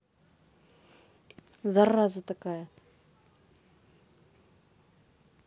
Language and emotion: Russian, angry